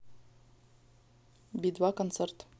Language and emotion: Russian, neutral